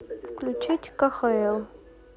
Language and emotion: Russian, neutral